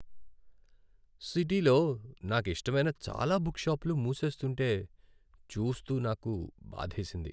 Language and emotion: Telugu, sad